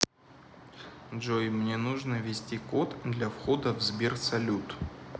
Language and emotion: Russian, neutral